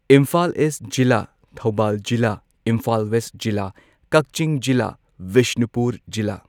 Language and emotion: Manipuri, neutral